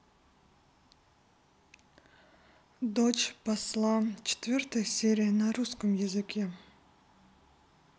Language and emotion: Russian, neutral